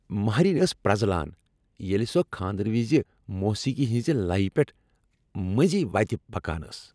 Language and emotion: Kashmiri, happy